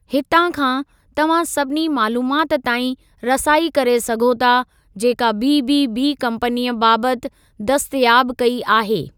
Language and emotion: Sindhi, neutral